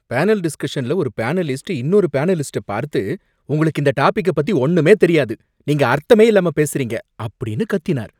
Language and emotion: Tamil, angry